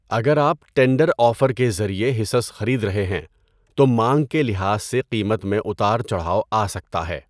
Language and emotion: Urdu, neutral